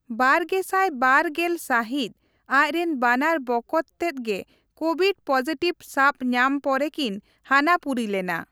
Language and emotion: Santali, neutral